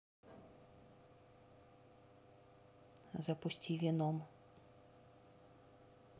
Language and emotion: Russian, neutral